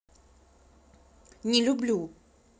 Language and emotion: Russian, angry